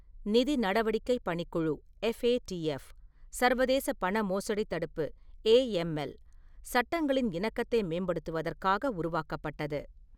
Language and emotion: Tamil, neutral